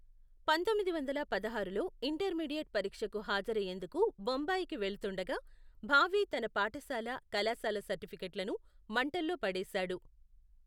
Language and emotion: Telugu, neutral